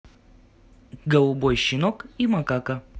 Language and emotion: Russian, positive